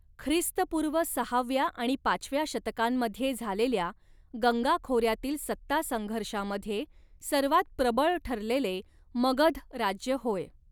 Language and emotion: Marathi, neutral